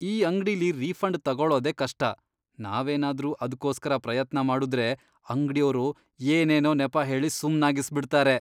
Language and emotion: Kannada, disgusted